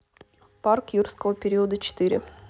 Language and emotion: Russian, neutral